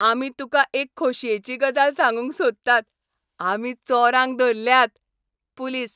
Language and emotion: Goan Konkani, happy